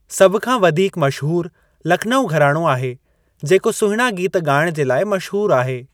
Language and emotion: Sindhi, neutral